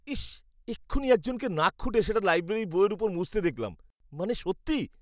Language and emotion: Bengali, disgusted